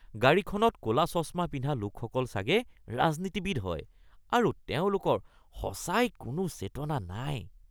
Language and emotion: Assamese, disgusted